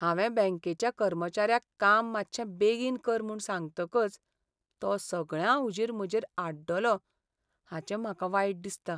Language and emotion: Goan Konkani, sad